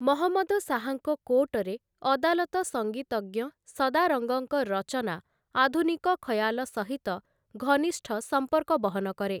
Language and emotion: Odia, neutral